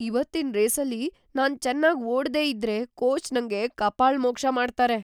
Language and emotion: Kannada, fearful